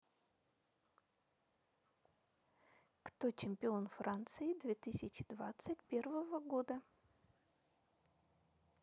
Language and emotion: Russian, neutral